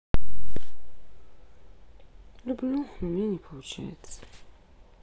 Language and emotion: Russian, sad